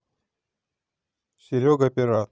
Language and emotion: Russian, neutral